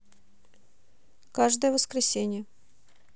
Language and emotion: Russian, neutral